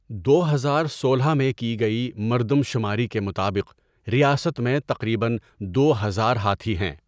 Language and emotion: Urdu, neutral